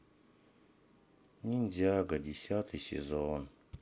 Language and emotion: Russian, sad